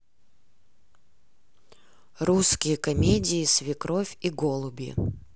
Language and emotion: Russian, neutral